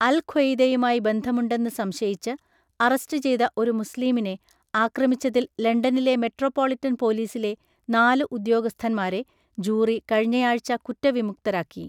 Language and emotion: Malayalam, neutral